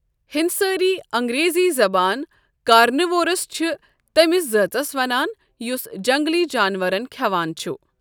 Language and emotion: Kashmiri, neutral